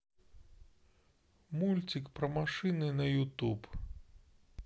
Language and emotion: Russian, sad